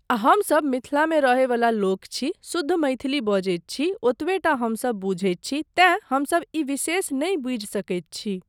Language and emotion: Maithili, neutral